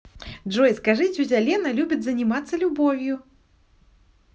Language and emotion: Russian, positive